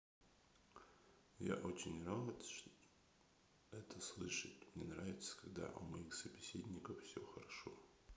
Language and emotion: Russian, neutral